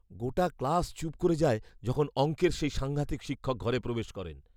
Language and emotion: Bengali, fearful